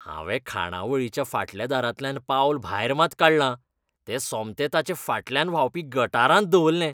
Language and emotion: Goan Konkani, disgusted